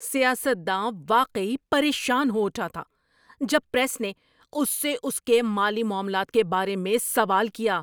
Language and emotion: Urdu, angry